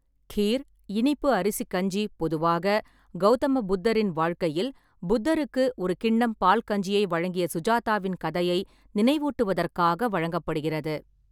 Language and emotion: Tamil, neutral